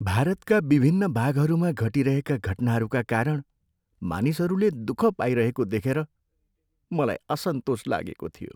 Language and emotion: Nepali, sad